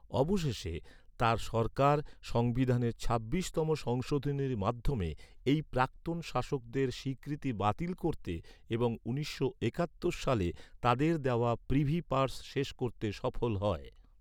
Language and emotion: Bengali, neutral